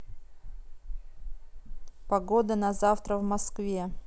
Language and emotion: Russian, neutral